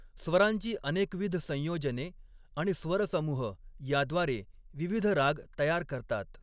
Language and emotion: Marathi, neutral